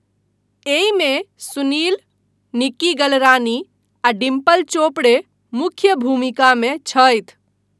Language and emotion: Maithili, neutral